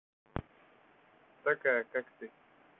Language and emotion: Russian, neutral